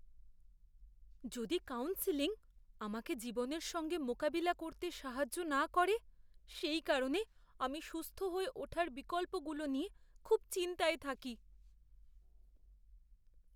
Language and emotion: Bengali, fearful